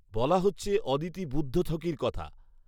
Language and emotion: Bengali, neutral